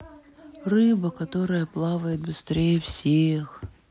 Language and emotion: Russian, sad